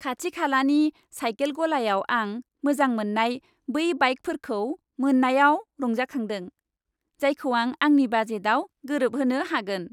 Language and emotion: Bodo, happy